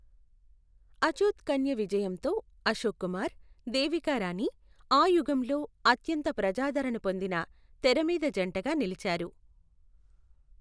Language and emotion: Telugu, neutral